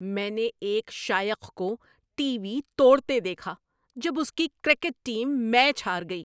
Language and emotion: Urdu, angry